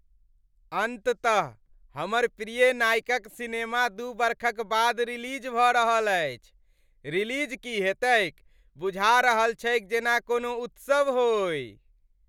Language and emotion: Maithili, happy